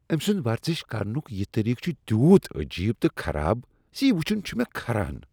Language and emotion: Kashmiri, disgusted